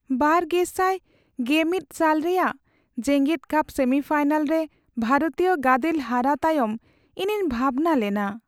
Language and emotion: Santali, sad